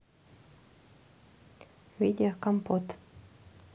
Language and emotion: Russian, neutral